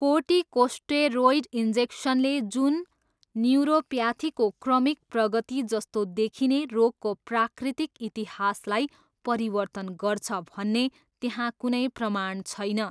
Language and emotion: Nepali, neutral